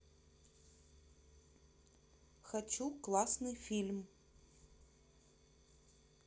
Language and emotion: Russian, neutral